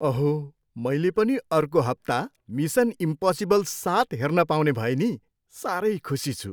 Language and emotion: Nepali, happy